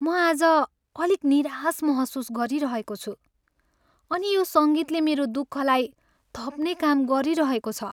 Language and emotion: Nepali, sad